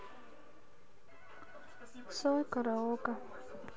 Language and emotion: Russian, neutral